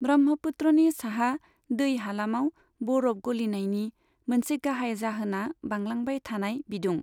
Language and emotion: Bodo, neutral